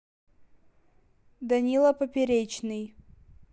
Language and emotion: Russian, neutral